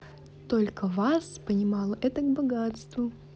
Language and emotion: Russian, positive